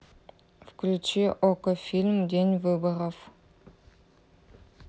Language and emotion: Russian, neutral